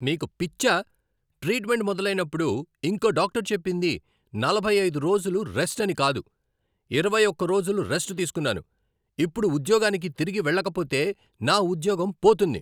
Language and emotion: Telugu, angry